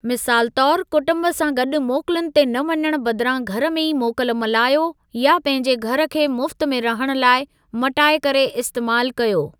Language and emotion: Sindhi, neutral